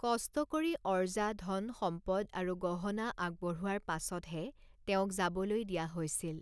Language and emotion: Assamese, neutral